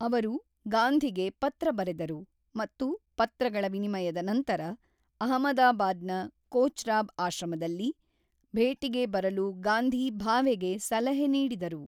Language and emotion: Kannada, neutral